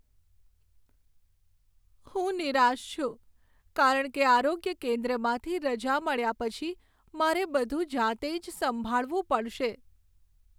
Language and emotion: Gujarati, sad